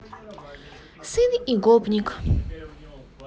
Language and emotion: Russian, positive